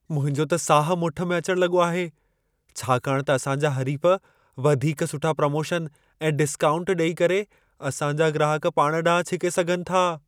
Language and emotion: Sindhi, fearful